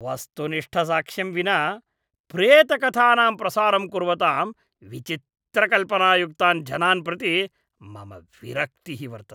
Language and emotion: Sanskrit, disgusted